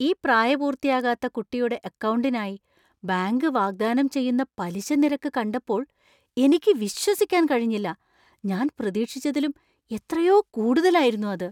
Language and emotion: Malayalam, surprised